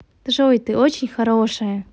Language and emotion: Russian, positive